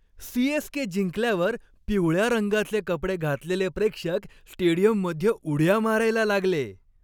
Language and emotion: Marathi, happy